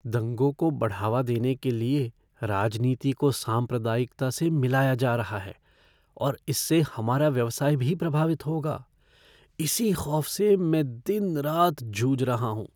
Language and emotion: Hindi, fearful